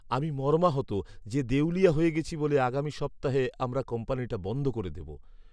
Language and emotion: Bengali, sad